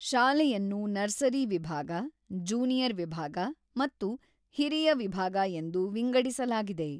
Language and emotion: Kannada, neutral